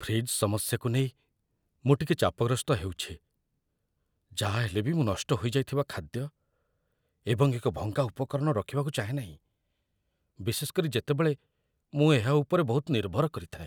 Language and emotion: Odia, fearful